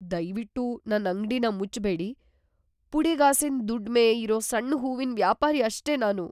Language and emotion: Kannada, fearful